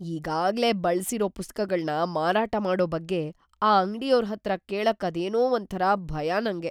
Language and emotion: Kannada, fearful